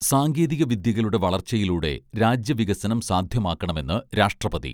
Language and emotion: Malayalam, neutral